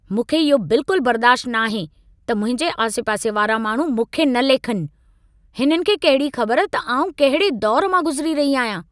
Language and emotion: Sindhi, angry